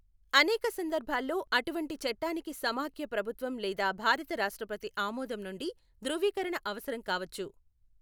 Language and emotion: Telugu, neutral